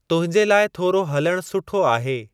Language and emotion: Sindhi, neutral